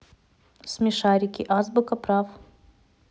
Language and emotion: Russian, neutral